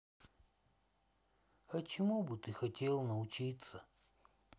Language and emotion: Russian, sad